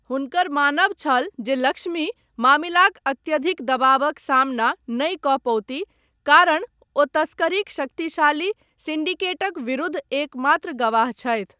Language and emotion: Maithili, neutral